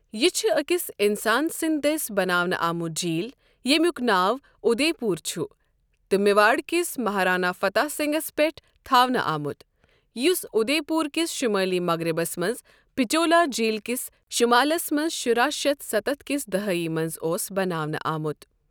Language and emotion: Kashmiri, neutral